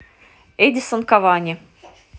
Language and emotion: Russian, neutral